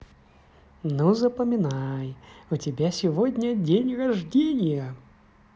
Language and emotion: Russian, positive